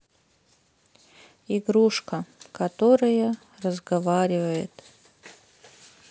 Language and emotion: Russian, sad